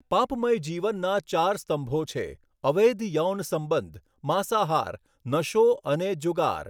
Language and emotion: Gujarati, neutral